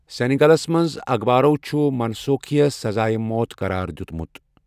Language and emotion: Kashmiri, neutral